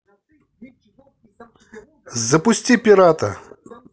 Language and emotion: Russian, positive